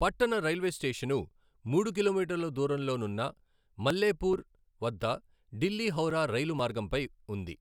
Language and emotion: Telugu, neutral